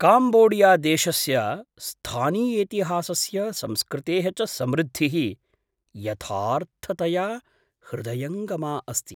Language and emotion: Sanskrit, surprised